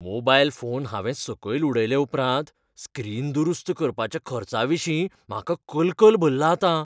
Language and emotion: Goan Konkani, fearful